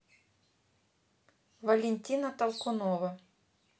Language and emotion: Russian, neutral